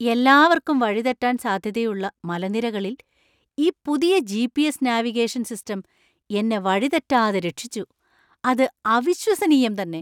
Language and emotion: Malayalam, surprised